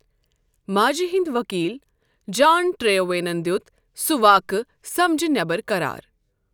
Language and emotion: Kashmiri, neutral